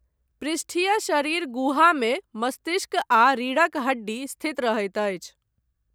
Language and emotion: Maithili, neutral